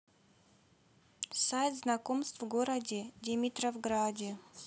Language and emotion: Russian, neutral